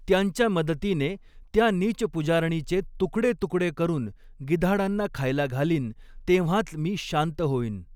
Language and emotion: Marathi, neutral